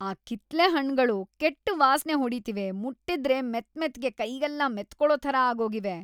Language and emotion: Kannada, disgusted